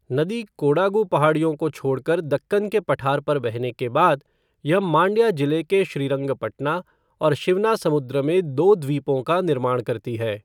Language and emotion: Hindi, neutral